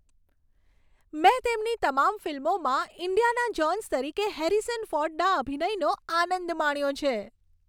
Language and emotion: Gujarati, happy